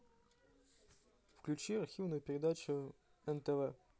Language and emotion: Russian, neutral